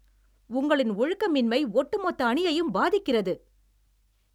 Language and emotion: Tamil, angry